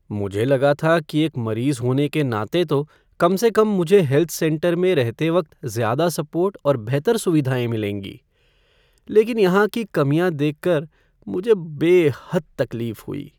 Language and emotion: Hindi, sad